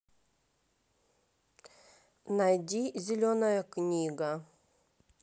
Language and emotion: Russian, neutral